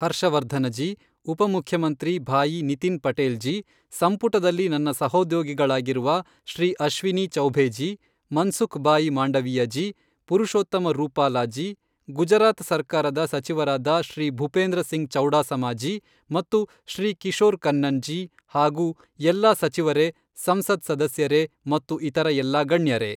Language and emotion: Kannada, neutral